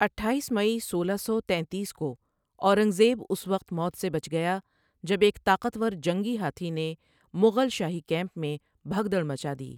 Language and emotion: Urdu, neutral